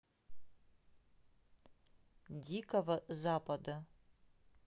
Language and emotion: Russian, neutral